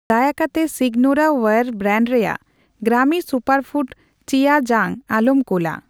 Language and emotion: Santali, neutral